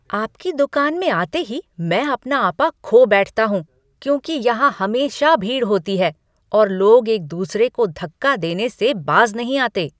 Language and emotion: Hindi, angry